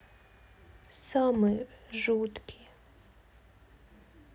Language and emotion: Russian, sad